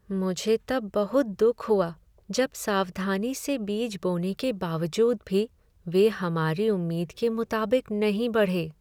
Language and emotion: Hindi, sad